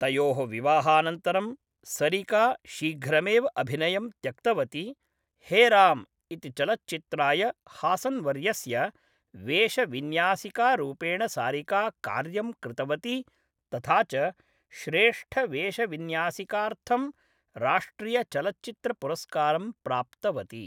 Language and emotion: Sanskrit, neutral